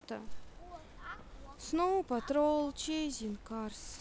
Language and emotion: Russian, sad